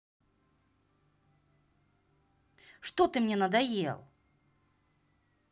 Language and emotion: Russian, angry